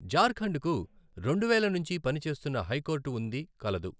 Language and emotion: Telugu, neutral